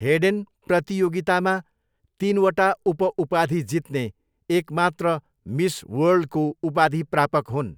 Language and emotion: Nepali, neutral